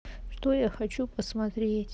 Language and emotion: Russian, sad